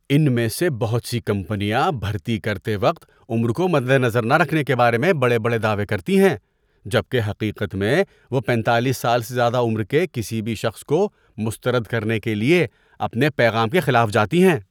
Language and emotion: Urdu, disgusted